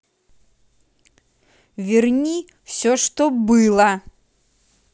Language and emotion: Russian, angry